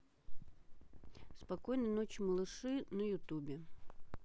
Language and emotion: Russian, neutral